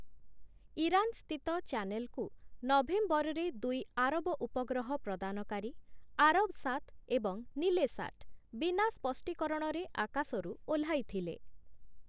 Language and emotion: Odia, neutral